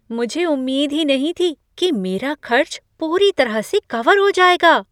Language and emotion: Hindi, surprised